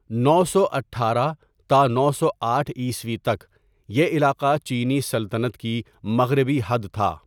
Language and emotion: Urdu, neutral